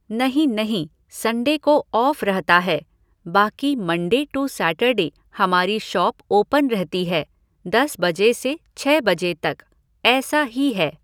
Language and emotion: Hindi, neutral